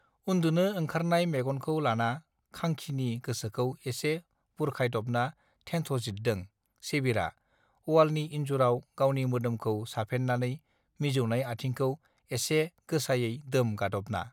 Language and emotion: Bodo, neutral